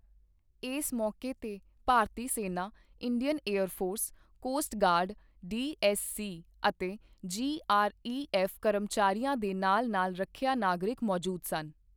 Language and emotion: Punjabi, neutral